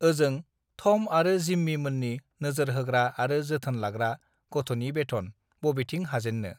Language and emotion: Bodo, neutral